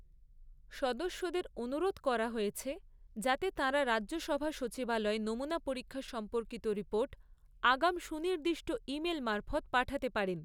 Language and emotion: Bengali, neutral